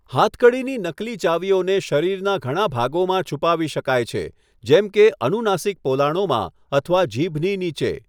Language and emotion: Gujarati, neutral